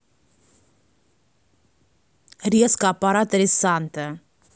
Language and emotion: Russian, neutral